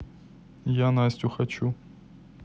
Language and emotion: Russian, neutral